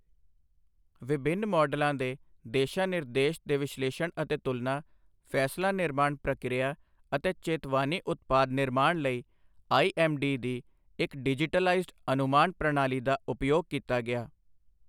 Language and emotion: Punjabi, neutral